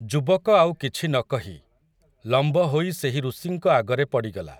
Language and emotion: Odia, neutral